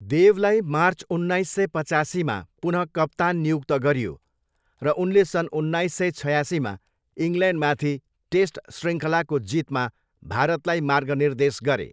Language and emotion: Nepali, neutral